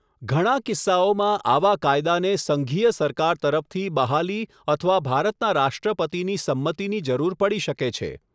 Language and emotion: Gujarati, neutral